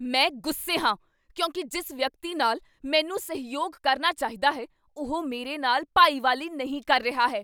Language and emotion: Punjabi, angry